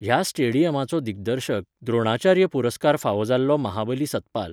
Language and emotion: Goan Konkani, neutral